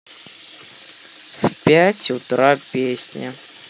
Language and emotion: Russian, neutral